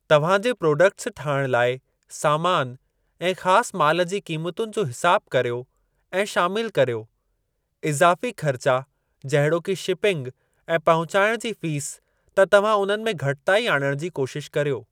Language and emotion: Sindhi, neutral